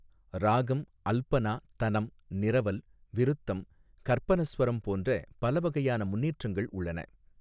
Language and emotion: Tamil, neutral